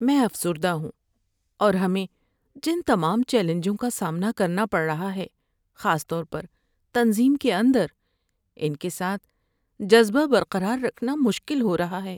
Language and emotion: Urdu, sad